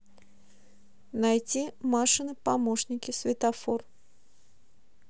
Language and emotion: Russian, neutral